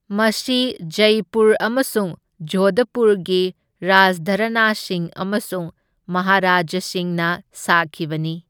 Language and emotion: Manipuri, neutral